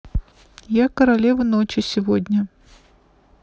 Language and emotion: Russian, neutral